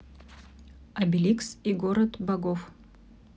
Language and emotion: Russian, neutral